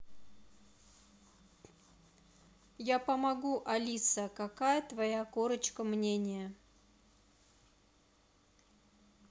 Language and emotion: Russian, neutral